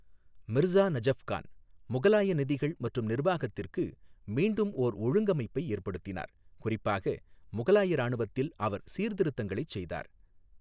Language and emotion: Tamil, neutral